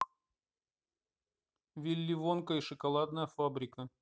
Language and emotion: Russian, neutral